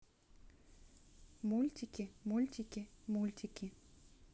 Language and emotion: Russian, neutral